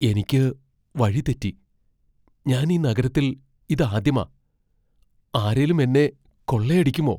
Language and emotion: Malayalam, fearful